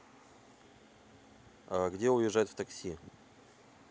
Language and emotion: Russian, neutral